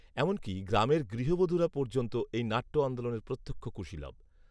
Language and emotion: Bengali, neutral